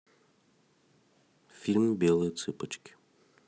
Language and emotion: Russian, neutral